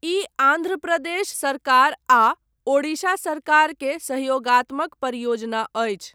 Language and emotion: Maithili, neutral